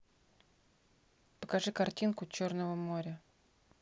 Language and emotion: Russian, neutral